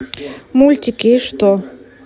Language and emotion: Russian, neutral